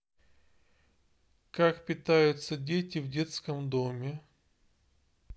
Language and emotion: Russian, neutral